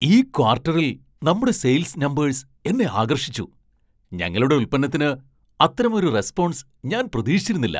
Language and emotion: Malayalam, surprised